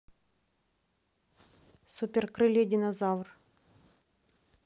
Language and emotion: Russian, neutral